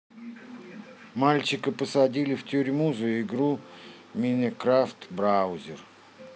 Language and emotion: Russian, neutral